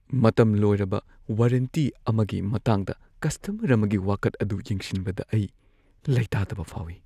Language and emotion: Manipuri, fearful